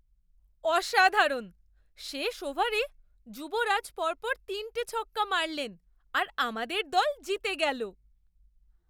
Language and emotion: Bengali, surprised